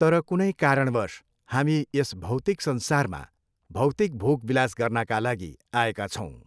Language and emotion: Nepali, neutral